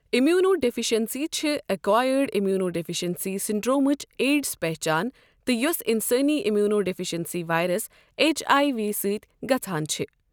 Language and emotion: Kashmiri, neutral